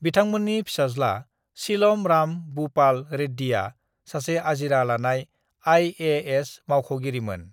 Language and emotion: Bodo, neutral